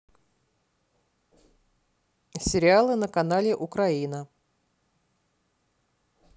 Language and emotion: Russian, neutral